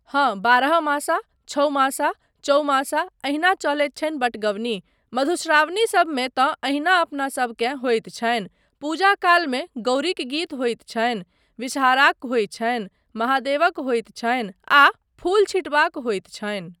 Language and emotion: Maithili, neutral